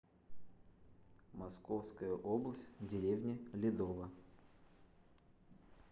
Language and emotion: Russian, neutral